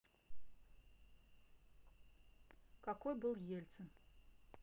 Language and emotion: Russian, neutral